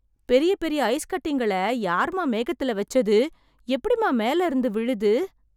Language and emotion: Tamil, surprised